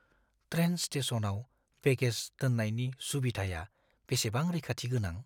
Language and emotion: Bodo, fearful